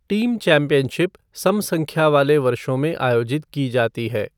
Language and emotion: Hindi, neutral